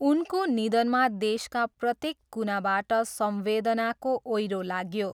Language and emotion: Nepali, neutral